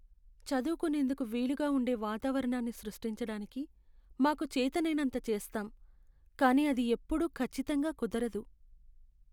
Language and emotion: Telugu, sad